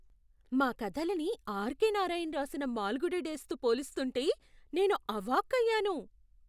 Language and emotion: Telugu, surprised